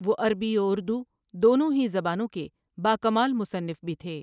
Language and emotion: Urdu, neutral